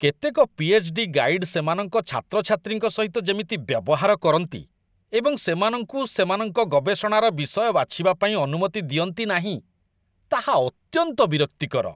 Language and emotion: Odia, disgusted